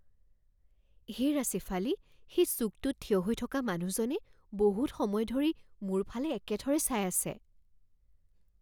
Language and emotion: Assamese, fearful